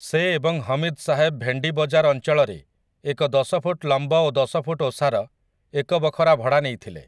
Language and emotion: Odia, neutral